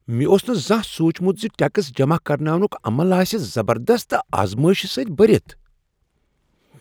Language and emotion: Kashmiri, surprised